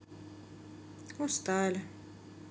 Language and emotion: Russian, sad